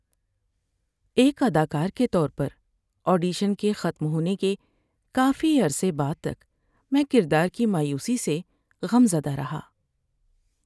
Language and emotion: Urdu, sad